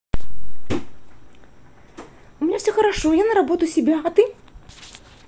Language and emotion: Russian, positive